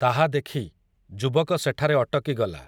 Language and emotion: Odia, neutral